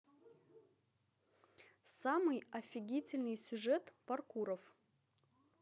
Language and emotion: Russian, positive